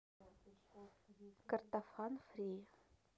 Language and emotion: Russian, neutral